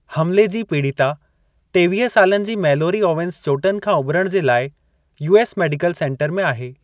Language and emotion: Sindhi, neutral